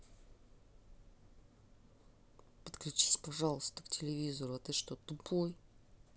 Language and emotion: Russian, angry